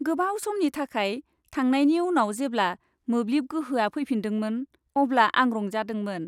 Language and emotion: Bodo, happy